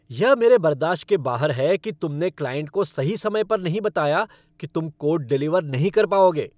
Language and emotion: Hindi, angry